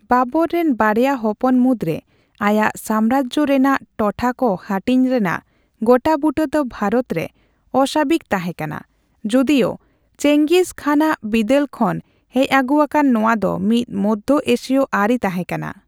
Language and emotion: Santali, neutral